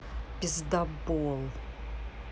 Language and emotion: Russian, angry